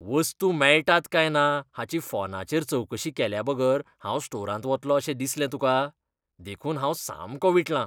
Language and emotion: Goan Konkani, disgusted